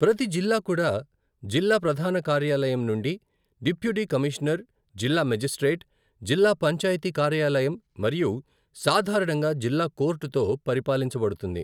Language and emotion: Telugu, neutral